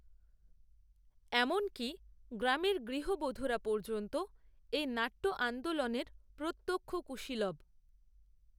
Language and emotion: Bengali, neutral